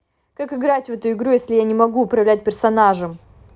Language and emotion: Russian, angry